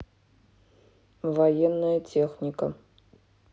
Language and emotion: Russian, neutral